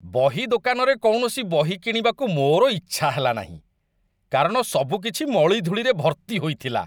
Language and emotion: Odia, disgusted